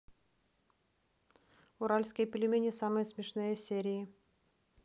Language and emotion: Russian, neutral